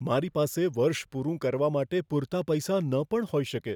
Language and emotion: Gujarati, fearful